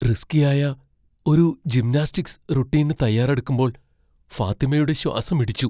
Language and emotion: Malayalam, fearful